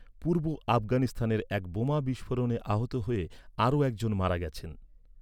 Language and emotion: Bengali, neutral